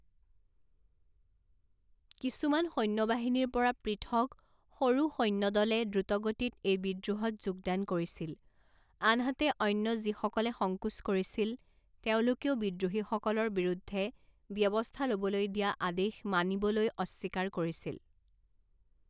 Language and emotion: Assamese, neutral